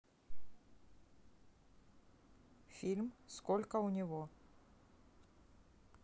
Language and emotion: Russian, neutral